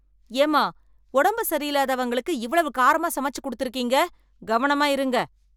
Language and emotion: Tamil, angry